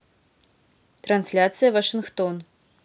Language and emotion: Russian, neutral